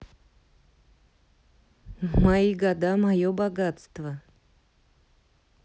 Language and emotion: Russian, neutral